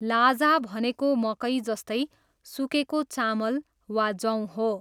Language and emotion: Nepali, neutral